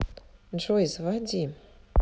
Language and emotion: Russian, neutral